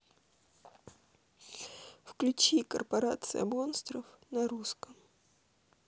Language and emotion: Russian, sad